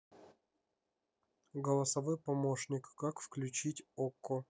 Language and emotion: Russian, neutral